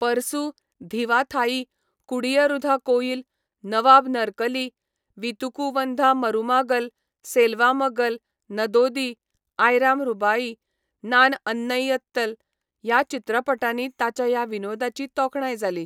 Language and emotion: Goan Konkani, neutral